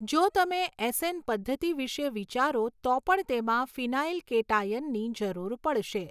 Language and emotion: Gujarati, neutral